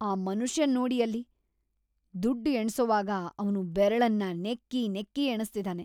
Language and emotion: Kannada, disgusted